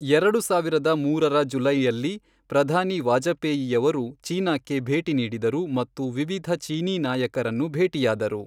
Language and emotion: Kannada, neutral